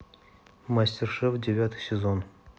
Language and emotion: Russian, neutral